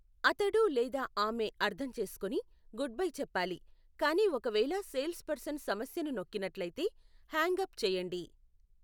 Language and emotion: Telugu, neutral